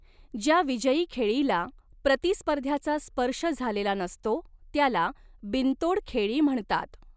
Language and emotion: Marathi, neutral